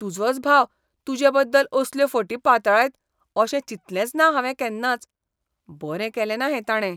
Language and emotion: Goan Konkani, disgusted